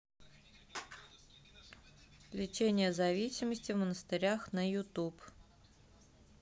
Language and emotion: Russian, neutral